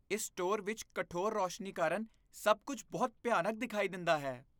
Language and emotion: Punjabi, disgusted